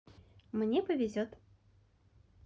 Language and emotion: Russian, positive